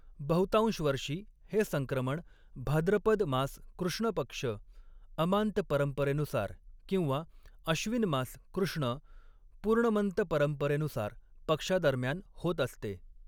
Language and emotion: Marathi, neutral